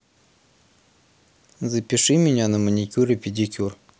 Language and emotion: Russian, neutral